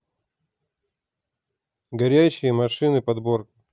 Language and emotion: Russian, neutral